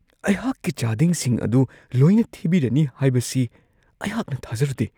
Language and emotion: Manipuri, surprised